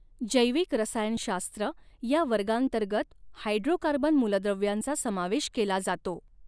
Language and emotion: Marathi, neutral